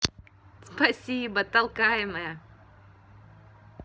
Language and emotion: Russian, positive